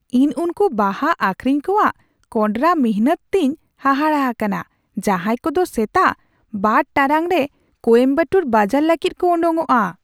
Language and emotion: Santali, surprised